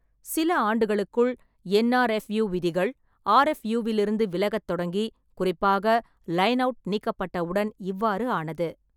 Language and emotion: Tamil, neutral